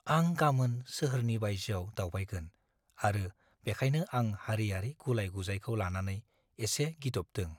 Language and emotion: Bodo, fearful